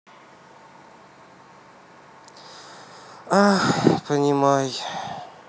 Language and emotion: Russian, sad